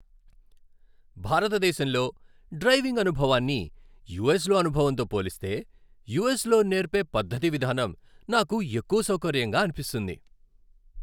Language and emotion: Telugu, happy